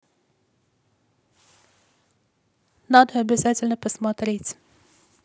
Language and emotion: Russian, neutral